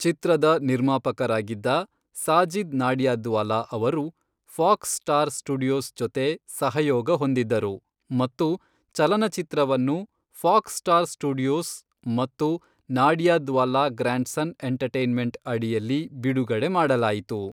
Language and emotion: Kannada, neutral